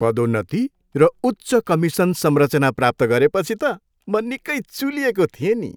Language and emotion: Nepali, happy